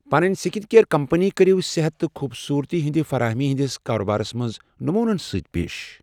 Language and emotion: Kashmiri, neutral